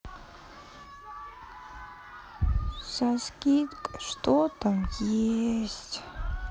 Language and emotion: Russian, sad